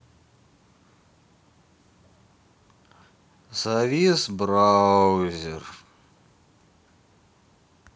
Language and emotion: Russian, sad